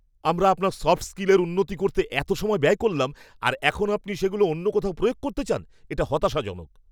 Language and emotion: Bengali, angry